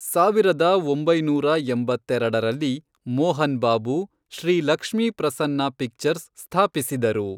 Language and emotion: Kannada, neutral